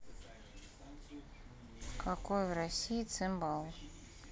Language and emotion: Russian, neutral